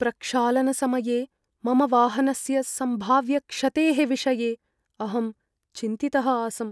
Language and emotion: Sanskrit, fearful